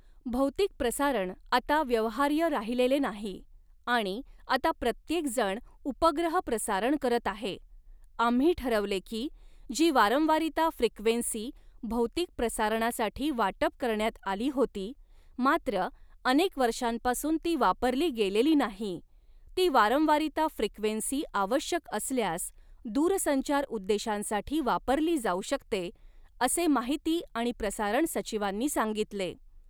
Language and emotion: Marathi, neutral